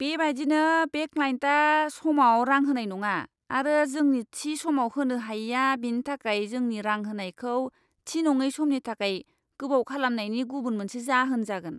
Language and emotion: Bodo, disgusted